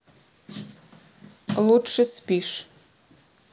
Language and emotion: Russian, neutral